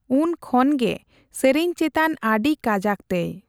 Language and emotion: Santali, neutral